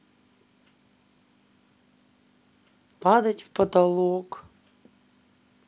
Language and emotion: Russian, sad